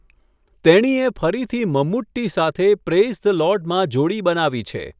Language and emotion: Gujarati, neutral